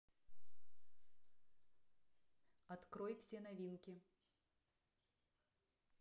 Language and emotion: Russian, neutral